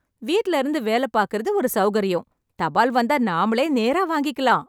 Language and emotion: Tamil, happy